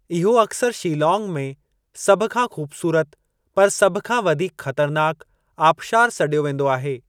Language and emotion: Sindhi, neutral